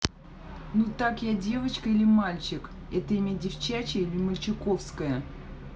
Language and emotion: Russian, neutral